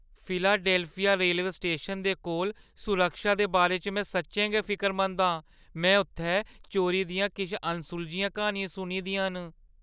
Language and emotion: Dogri, fearful